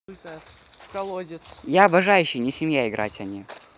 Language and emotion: Russian, positive